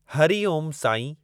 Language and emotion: Sindhi, neutral